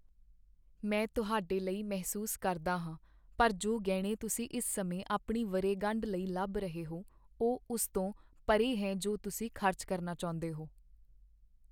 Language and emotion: Punjabi, sad